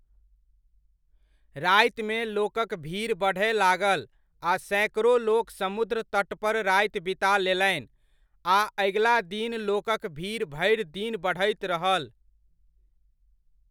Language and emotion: Maithili, neutral